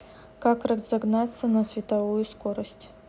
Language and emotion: Russian, neutral